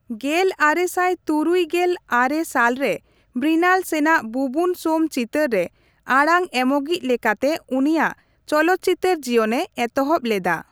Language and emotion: Santali, neutral